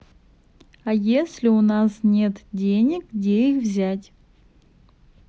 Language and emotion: Russian, neutral